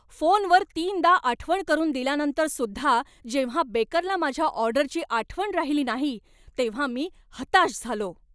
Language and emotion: Marathi, angry